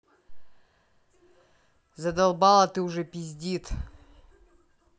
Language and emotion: Russian, angry